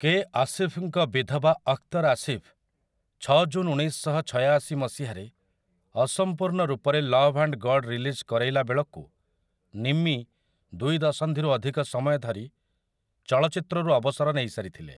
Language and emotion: Odia, neutral